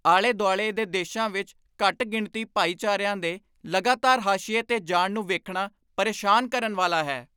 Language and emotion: Punjabi, angry